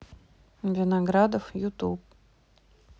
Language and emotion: Russian, neutral